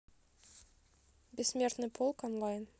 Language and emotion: Russian, neutral